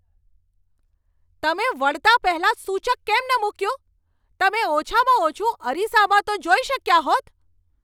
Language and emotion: Gujarati, angry